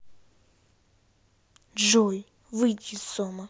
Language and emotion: Russian, angry